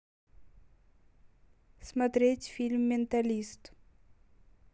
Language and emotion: Russian, neutral